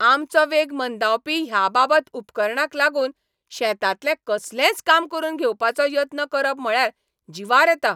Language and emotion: Goan Konkani, angry